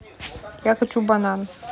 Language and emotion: Russian, neutral